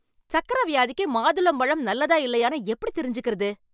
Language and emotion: Tamil, angry